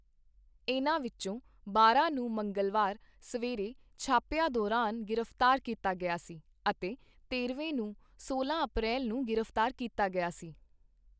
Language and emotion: Punjabi, neutral